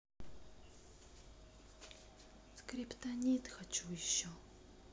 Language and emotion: Russian, neutral